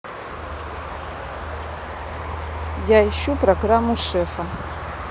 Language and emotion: Russian, neutral